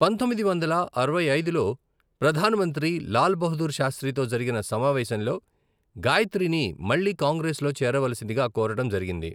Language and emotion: Telugu, neutral